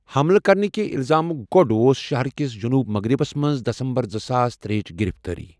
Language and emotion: Kashmiri, neutral